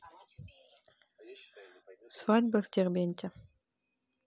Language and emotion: Russian, neutral